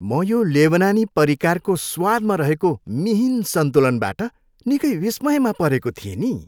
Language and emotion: Nepali, happy